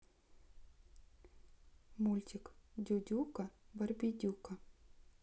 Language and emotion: Russian, neutral